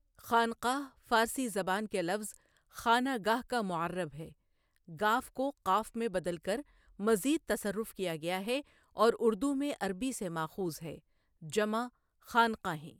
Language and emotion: Urdu, neutral